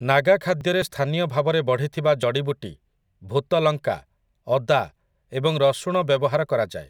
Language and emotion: Odia, neutral